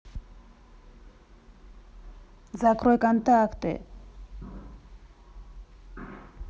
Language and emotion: Russian, angry